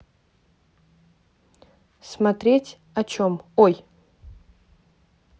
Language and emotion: Russian, neutral